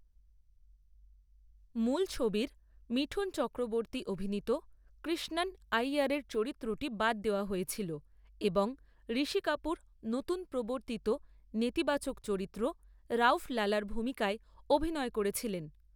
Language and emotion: Bengali, neutral